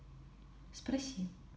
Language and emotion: Russian, neutral